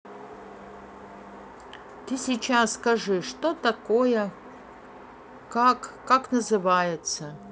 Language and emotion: Russian, neutral